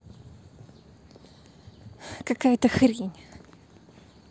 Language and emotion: Russian, angry